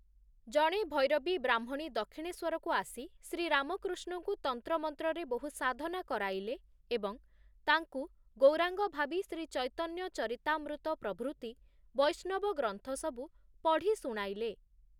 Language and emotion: Odia, neutral